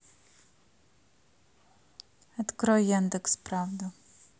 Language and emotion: Russian, neutral